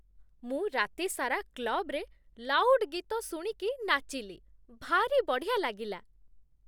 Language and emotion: Odia, happy